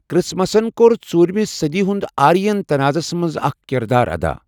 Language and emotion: Kashmiri, neutral